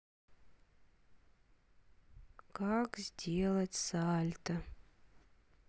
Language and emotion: Russian, sad